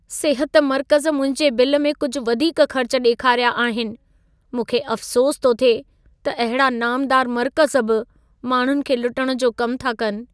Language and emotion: Sindhi, sad